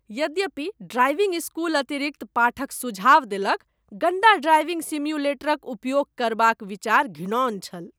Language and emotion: Maithili, disgusted